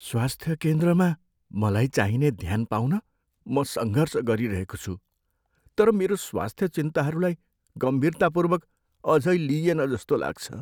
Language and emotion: Nepali, sad